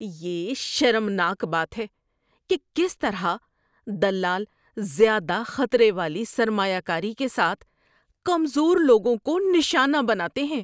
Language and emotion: Urdu, disgusted